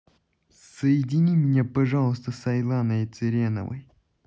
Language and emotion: Russian, angry